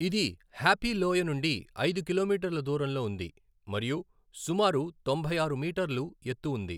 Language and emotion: Telugu, neutral